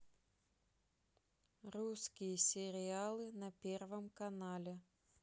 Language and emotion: Russian, neutral